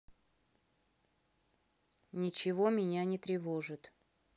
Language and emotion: Russian, neutral